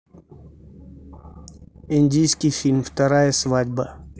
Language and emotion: Russian, neutral